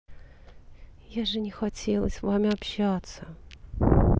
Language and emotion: Russian, sad